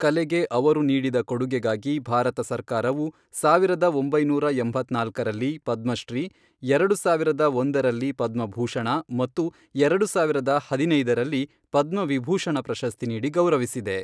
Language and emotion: Kannada, neutral